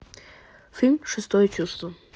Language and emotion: Russian, neutral